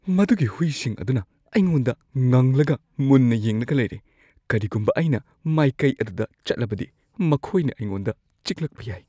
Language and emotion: Manipuri, fearful